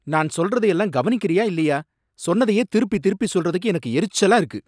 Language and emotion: Tamil, angry